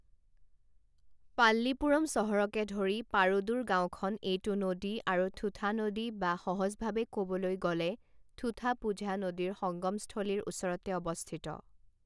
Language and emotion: Assamese, neutral